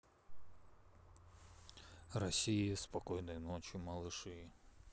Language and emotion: Russian, neutral